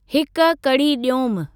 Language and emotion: Sindhi, neutral